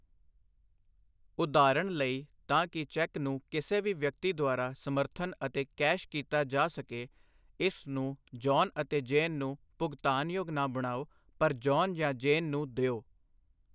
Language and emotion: Punjabi, neutral